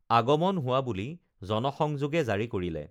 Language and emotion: Assamese, neutral